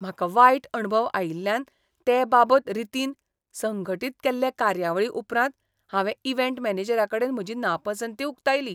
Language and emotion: Goan Konkani, disgusted